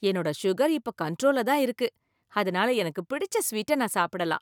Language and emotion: Tamil, happy